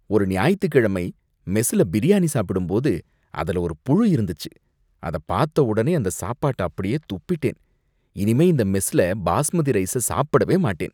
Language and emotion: Tamil, disgusted